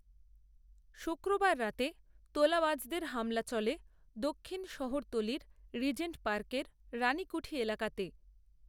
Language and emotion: Bengali, neutral